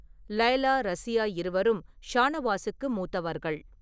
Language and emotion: Tamil, neutral